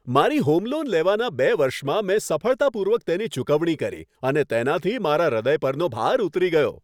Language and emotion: Gujarati, happy